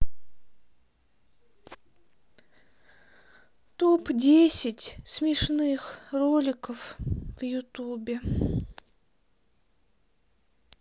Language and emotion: Russian, sad